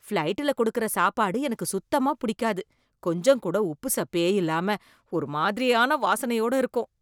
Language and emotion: Tamil, disgusted